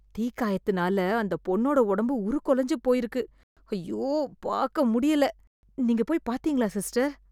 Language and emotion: Tamil, disgusted